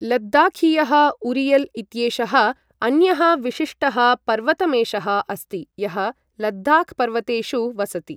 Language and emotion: Sanskrit, neutral